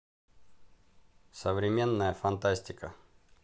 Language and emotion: Russian, neutral